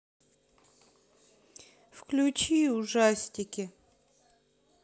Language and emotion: Russian, sad